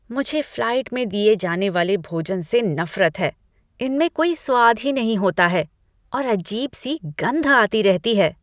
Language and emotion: Hindi, disgusted